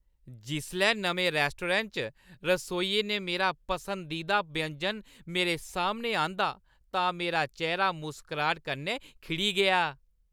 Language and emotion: Dogri, happy